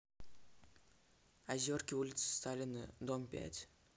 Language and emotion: Russian, neutral